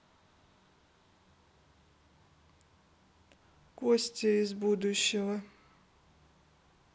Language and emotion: Russian, neutral